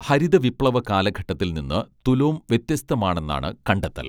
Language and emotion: Malayalam, neutral